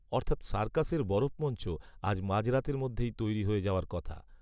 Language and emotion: Bengali, neutral